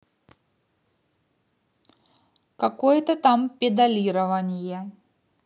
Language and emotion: Russian, neutral